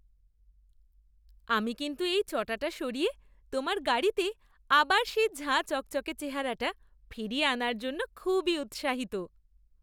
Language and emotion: Bengali, happy